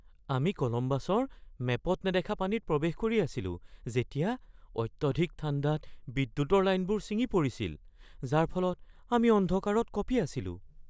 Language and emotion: Assamese, fearful